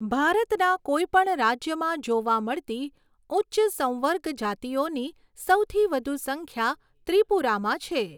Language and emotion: Gujarati, neutral